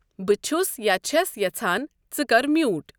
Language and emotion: Kashmiri, neutral